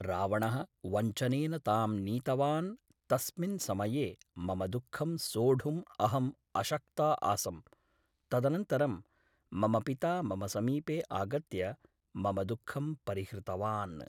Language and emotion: Sanskrit, neutral